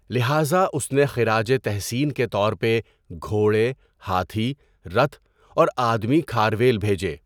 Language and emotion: Urdu, neutral